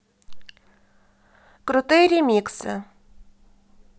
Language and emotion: Russian, neutral